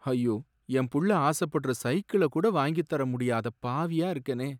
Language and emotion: Tamil, sad